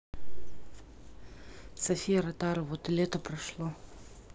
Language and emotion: Russian, neutral